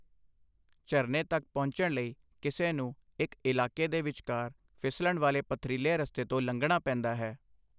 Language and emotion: Punjabi, neutral